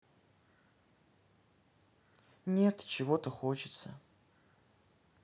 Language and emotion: Russian, neutral